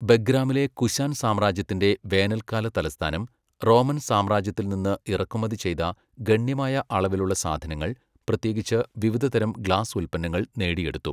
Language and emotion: Malayalam, neutral